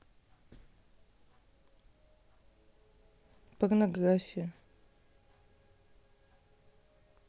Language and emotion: Russian, neutral